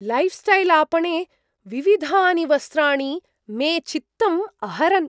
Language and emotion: Sanskrit, surprised